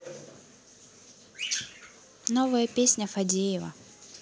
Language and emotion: Russian, neutral